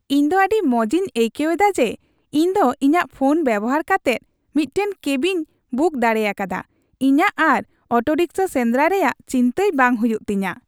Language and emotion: Santali, happy